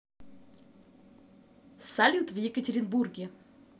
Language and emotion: Russian, positive